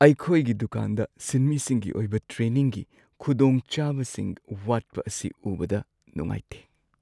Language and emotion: Manipuri, sad